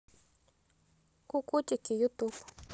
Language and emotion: Russian, neutral